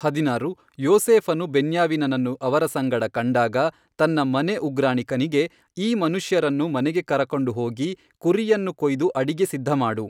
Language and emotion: Kannada, neutral